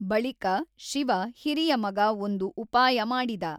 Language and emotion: Kannada, neutral